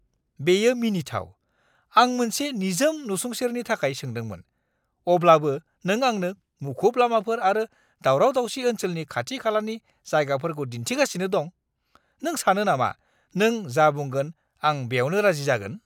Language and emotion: Bodo, angry